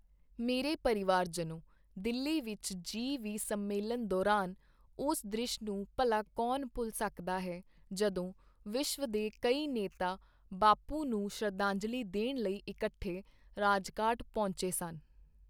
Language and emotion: Punjabi, neutral